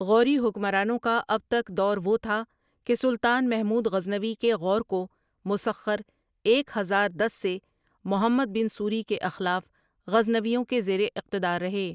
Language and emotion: Urdu, neutral